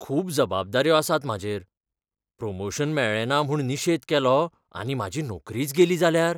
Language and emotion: Goan Konkani, fearful